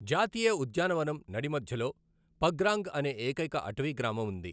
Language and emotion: Telugu, neutral